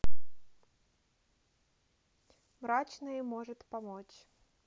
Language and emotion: Russian, neutral